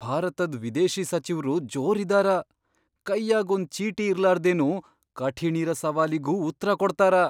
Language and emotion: Kannada, surprised